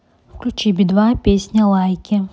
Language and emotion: Russian, neutral